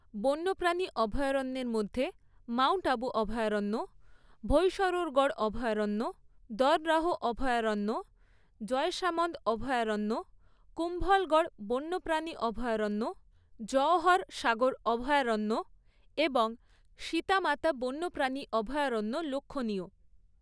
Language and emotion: Bengali, neutral